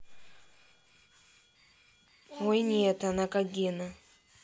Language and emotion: Russian, neutral